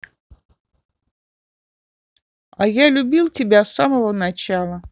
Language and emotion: Russian, neutral